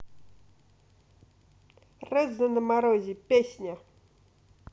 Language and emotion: Russian, neutral